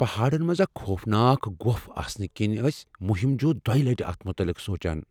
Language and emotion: Kashmiri, fearful